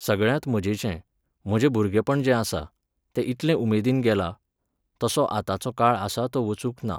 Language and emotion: Goan Konkani, neutral